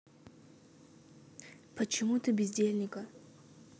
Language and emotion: Russian, neutral